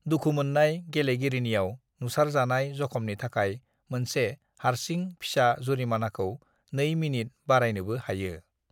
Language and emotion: Bodo, neutral